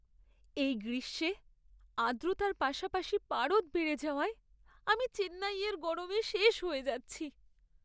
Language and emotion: Bengali, sad